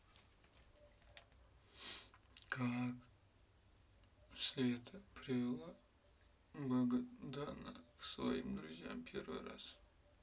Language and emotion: Russian, sad